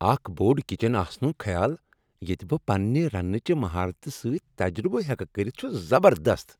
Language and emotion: Kashmiri, happy